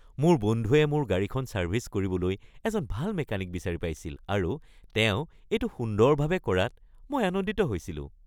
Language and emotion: Assamese, happy